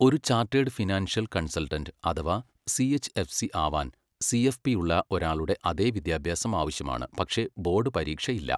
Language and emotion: Malayalam, neutral